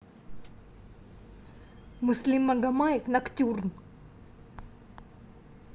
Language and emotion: Russian, angry